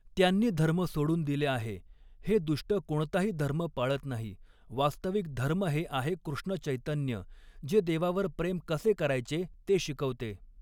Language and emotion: Marathi, neutral